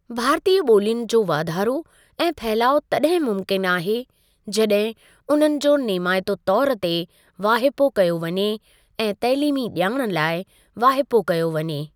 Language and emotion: Sindhi, neutral